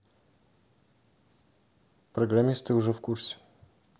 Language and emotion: Russian, neutral